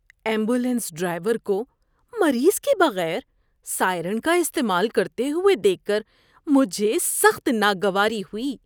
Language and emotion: Urdu, disgusted